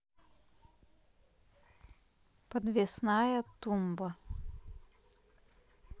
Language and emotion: Russian, neutral